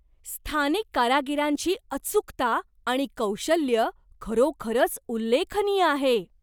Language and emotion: Marathi, surprised